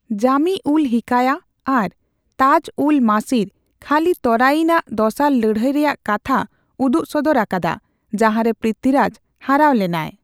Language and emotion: Santali, neutral